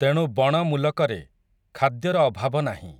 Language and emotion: Odia, neutral